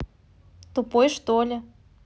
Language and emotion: Russian, neutral